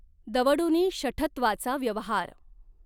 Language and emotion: Marathi, neutral